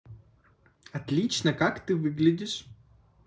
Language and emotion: Russian, positive